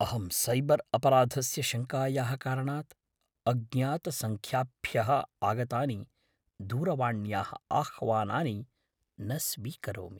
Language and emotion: Sanskrit, fearful